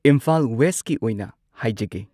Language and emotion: Manipuri, neutral